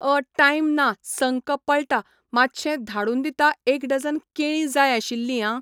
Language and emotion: Goan Konkani, neutral